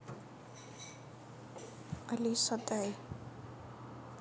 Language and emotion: Russian, neutral